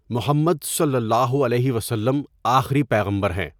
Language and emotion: Urdu, neutral